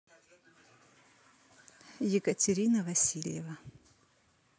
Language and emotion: Russian, neutral